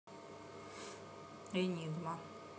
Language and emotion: Russian, neutral